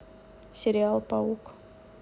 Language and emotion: Russian, neutral